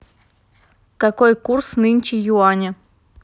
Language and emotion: Russian, neutral